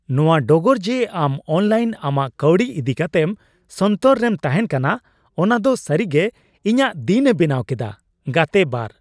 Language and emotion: Santali, happy